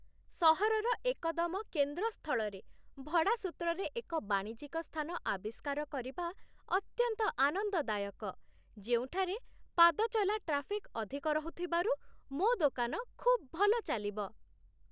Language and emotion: Odia, happy